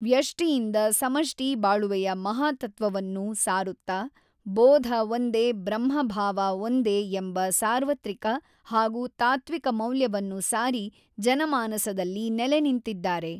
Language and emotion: Kannada, neutral